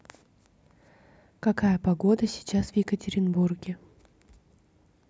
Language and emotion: Russian, neutral